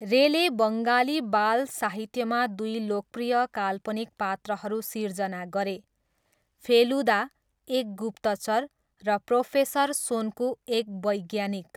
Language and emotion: Nepali, neutral